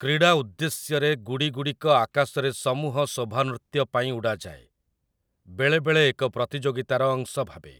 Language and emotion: Odia, neutral